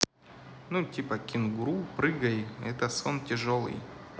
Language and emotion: Russian, neutral